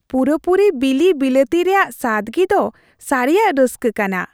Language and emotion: Santali, happy